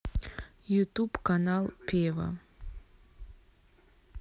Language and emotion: Russian, neutral